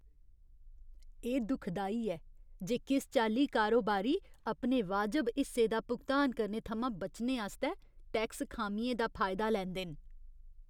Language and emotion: Dogri, disgusted